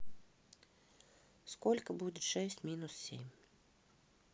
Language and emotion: Russian, neutral